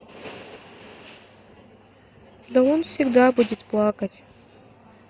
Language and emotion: Russian, neutral